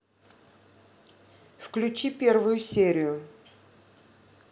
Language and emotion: Russian, neutral